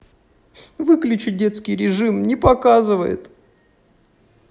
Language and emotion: Russian, sad